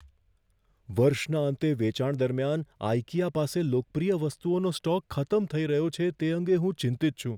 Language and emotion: Gujarati, fearful